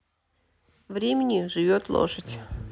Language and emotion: Russian, neutral